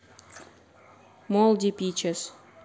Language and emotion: Russian, neutral